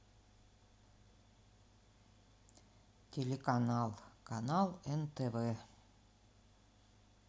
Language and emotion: Russian, neutral